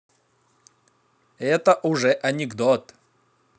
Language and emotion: Russian, positive